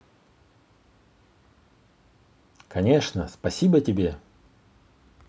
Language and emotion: Russian, positive